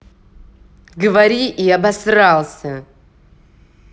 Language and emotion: Russian, angry